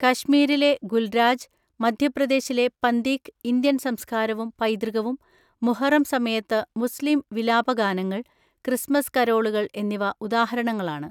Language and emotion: Malayalam, neutral